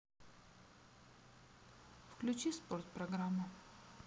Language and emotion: Russian, neutral